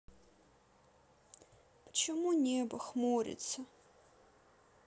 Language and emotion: Russian, sad